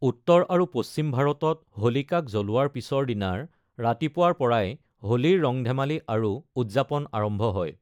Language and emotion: Assamese, neutral